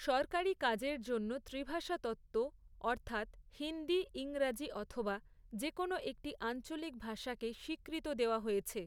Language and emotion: Bengali, neutral